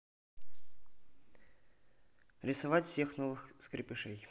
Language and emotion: Russian, neutral